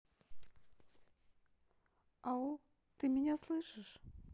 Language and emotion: Russian, neutral